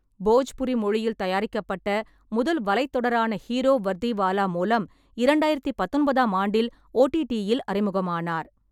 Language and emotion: Tamil, neutral